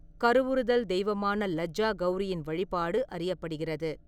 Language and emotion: Tamil, neutral